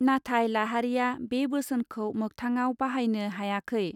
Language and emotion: Bodo, neutral